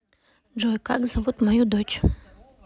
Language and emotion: Russian, neutral